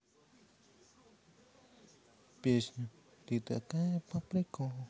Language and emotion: Russian, positive